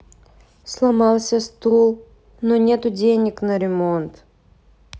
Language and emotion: Russian, sad